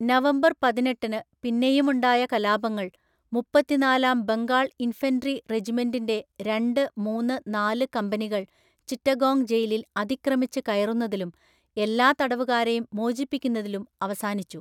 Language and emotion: Malayalam, neutral